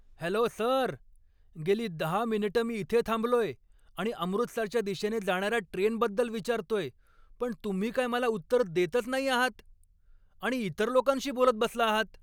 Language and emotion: Marathi, angry